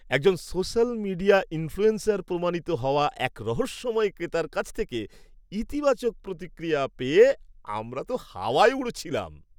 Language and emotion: Bengali, happy